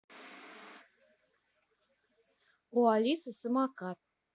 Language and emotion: Russian, neutral